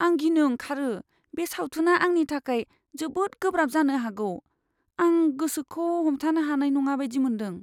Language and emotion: Bodo, fearful